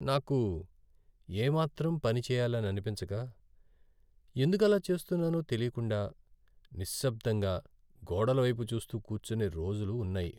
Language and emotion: Telugu, sad